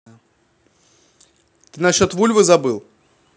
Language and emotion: Russian, neutral